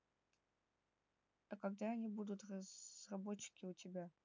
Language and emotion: Russian, neutral